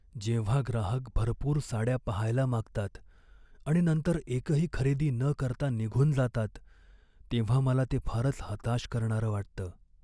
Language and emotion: Marathi, sad